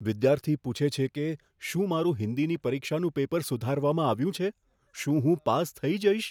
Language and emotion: Gujarati, fearful